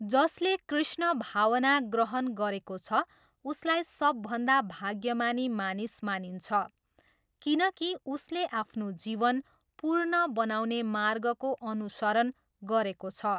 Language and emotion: Nepali, neutral